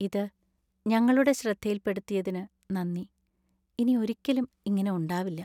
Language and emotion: Malayalam, sad